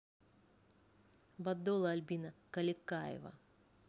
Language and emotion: Russian, neutral